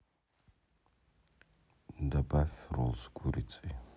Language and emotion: Russian, neutral